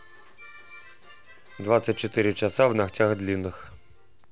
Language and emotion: Russian, neutral